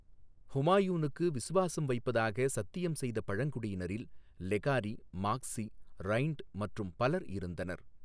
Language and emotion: Tamil, neutral